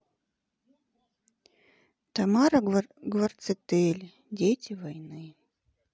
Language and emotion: Russian, sad